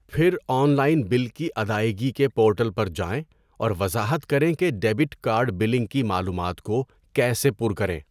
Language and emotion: Urdu, neutral